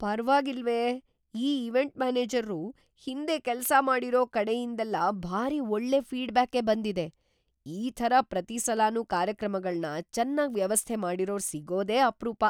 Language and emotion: Kannada, surprised